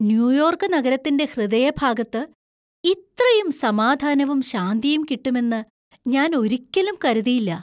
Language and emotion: Malayalam, surprised